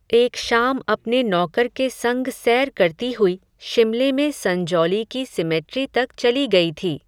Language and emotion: Hindi, neutral